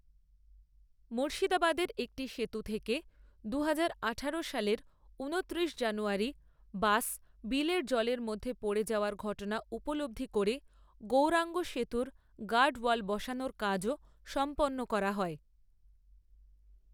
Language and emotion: Bengali, neutral